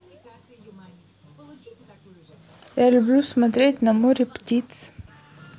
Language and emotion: Russian, neutral